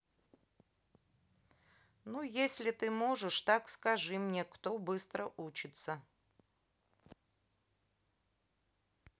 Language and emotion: Russian, neutral